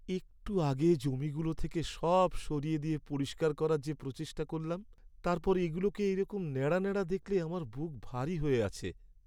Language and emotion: Bengali, sad